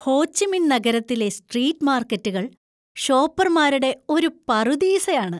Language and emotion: Malayalam, happy